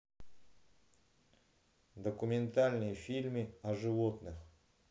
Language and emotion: Russian, neutral